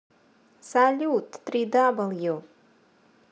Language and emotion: Russian, positive